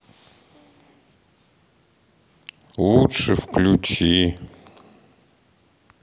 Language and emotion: Russian, sad